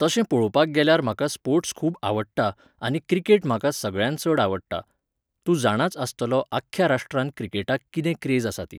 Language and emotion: Goan Konkani, neutral